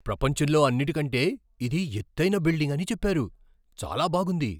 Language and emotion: Telugu, surprised